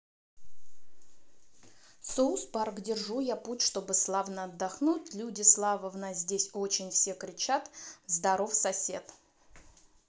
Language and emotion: Russian, neutral